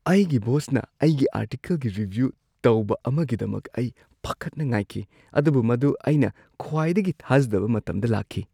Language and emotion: Manipuri, surprised